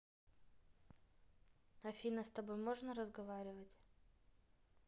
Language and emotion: Russian, neutral